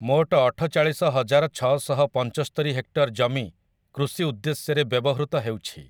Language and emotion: Odia, neutral